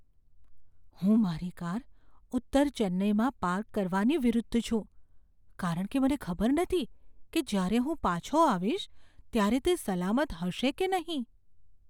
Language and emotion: Gujarati, fearful